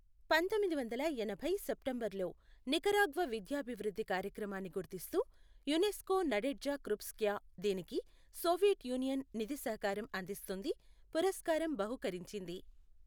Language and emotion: Telugu, neutral